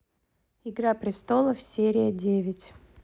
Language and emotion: Russian, neutral